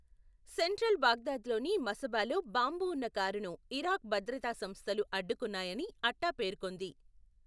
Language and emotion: Telugu, neutral